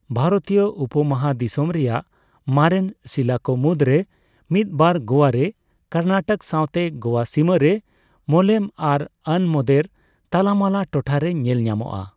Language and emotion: Santali, neutral